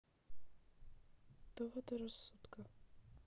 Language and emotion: Russian, sad